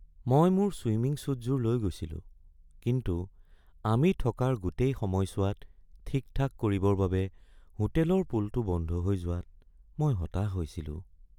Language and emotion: Assamese, sad